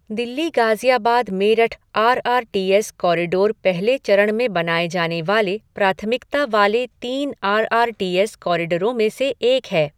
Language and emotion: Hindi, neutral